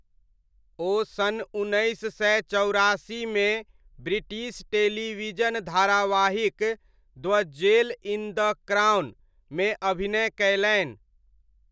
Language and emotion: Maithili, neutral